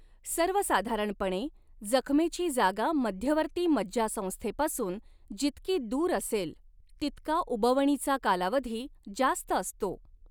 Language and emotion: Marathi, neutral